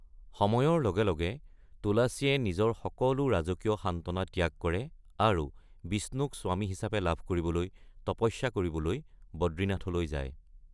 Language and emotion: Assamese, neutral